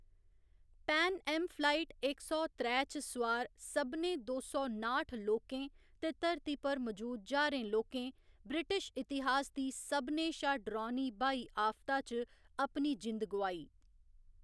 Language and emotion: Dogri, neutral